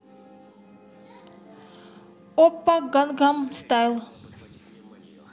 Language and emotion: Russian, positive